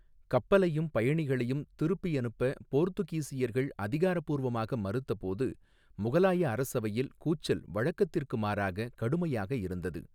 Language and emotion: Tamil, neutral